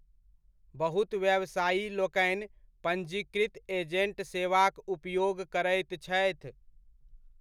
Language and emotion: Maithili, neutral